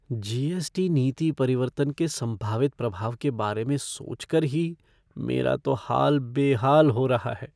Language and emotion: Hindi, fearful